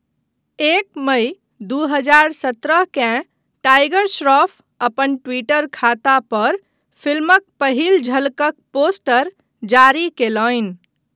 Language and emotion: Maithili, neutral